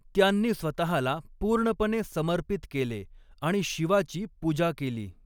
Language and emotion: Marathi, neutral